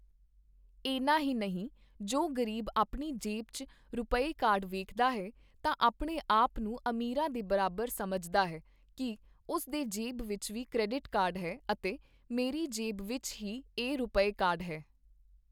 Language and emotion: Punjabi, neutral